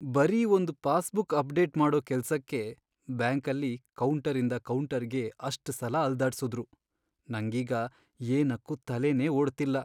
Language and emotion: Kannada, sad